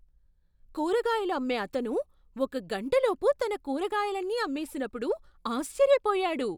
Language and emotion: Telugu, surprised